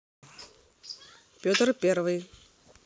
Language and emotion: Russian, neutral